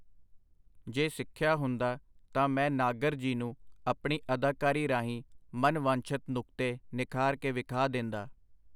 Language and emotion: Punjabi, neutral